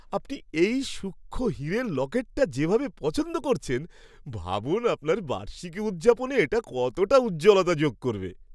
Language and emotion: Bengali, happy